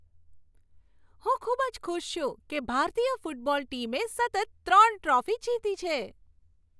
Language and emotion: Gujarati, happy